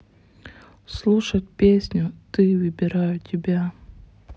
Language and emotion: Russian, neutral